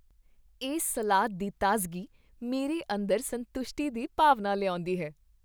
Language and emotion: Punjabi, happy